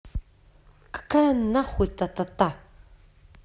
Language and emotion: Russian, angry